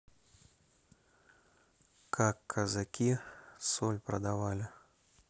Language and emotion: Russian, neutral